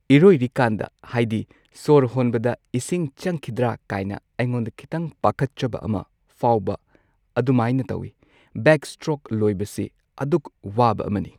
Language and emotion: Manipuri, neutral